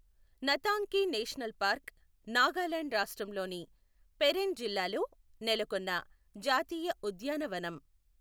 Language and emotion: Telugu, neutral